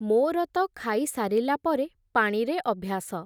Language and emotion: Odia, neutral